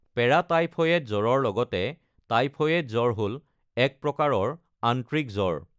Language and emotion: Assamese, neutral